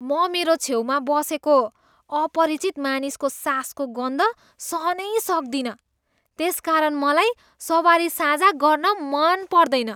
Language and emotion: Nepali, disgusted